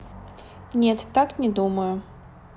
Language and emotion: Russian, neutral